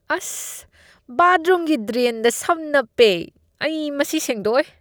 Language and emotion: Manipuri, disgusted